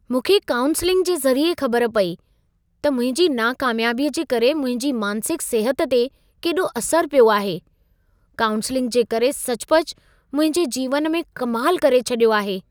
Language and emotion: Sindhi, surprised